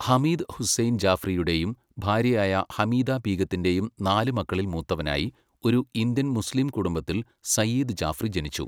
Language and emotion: Malayalam, neutral